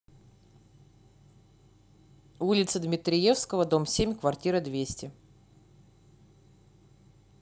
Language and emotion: Russian, neutral